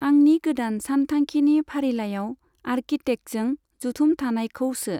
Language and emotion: Bodo, neutral